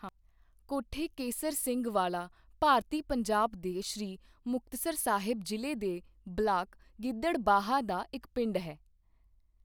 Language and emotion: Punjabi, neutral